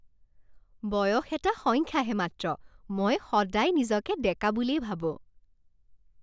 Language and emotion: Assamese, happy